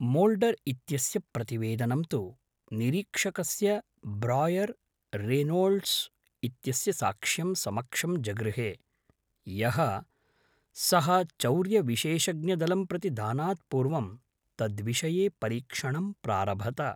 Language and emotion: Sanskrit, neutral